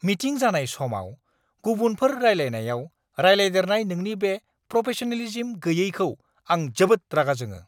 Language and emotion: Bodo, angry